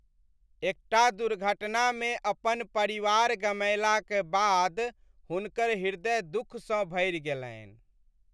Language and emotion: Maithili, sad